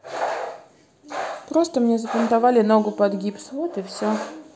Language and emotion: Russian, sad